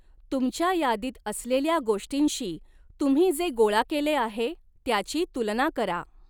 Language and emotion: Marathi, neutral